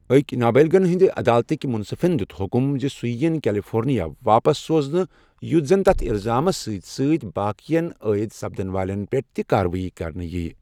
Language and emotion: Kashmiri, neutral